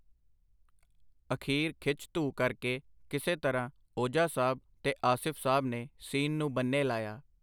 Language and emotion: Punjabi, neutral